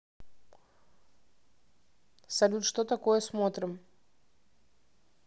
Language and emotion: Russian, neutral